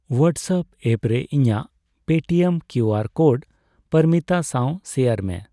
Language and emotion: Santali, neutral